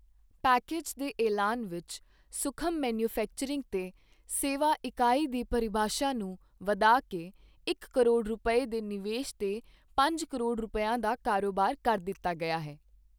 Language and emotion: Punjabi, neutral